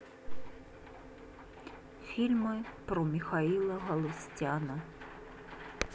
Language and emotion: Russian, sad